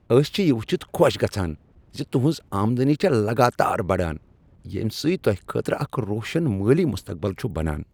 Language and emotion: Kashmiri, happy